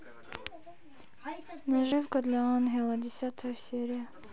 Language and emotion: Russian, neutral